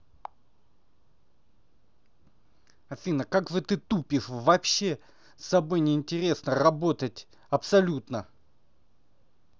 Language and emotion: Russian, angry